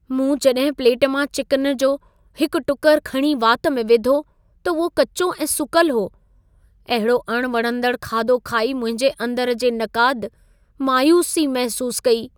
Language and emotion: Sindhi, sad